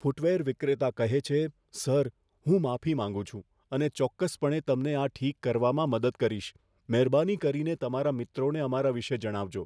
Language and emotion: Gujarati, fearful